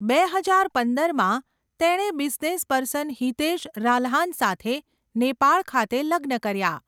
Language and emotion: Gujarati, neutral